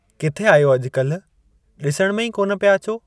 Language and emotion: Sindhi, neutral